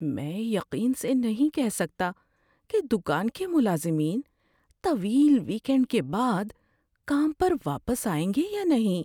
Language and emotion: Urdu, fearful